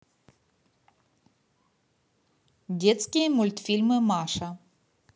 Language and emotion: Russian, neutral